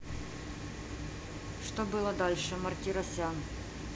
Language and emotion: Russian, neutral